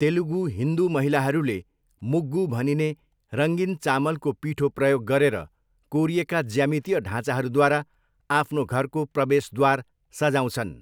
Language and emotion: Nepali, neutral